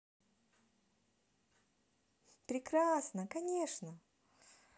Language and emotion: Russian, positive